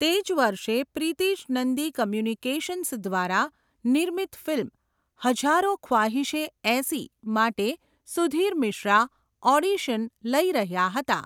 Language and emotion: Gujarati, neutral